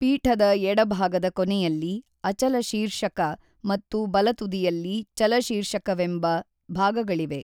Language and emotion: Kannada, neutral